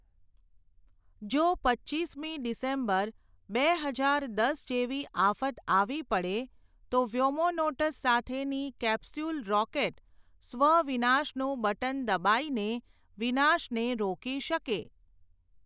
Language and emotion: Gujarati, neutral